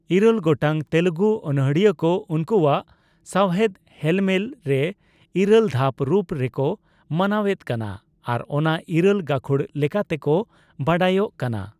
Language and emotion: Santali, neutral